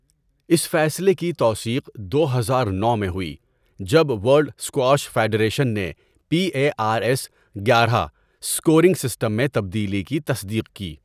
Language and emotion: Urdu, neutral